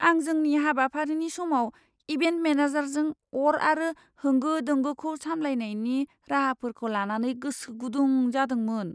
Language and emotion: Bodo, fearful